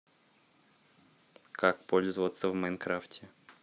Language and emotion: Russian, neutral